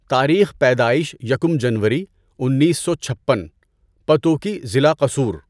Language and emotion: Urdu, neutral